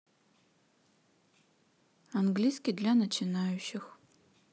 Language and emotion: Russian, neutral